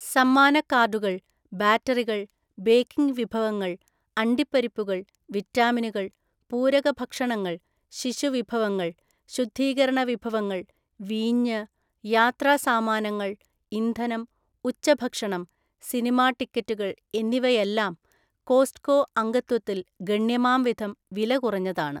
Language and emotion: Malayalam, neutral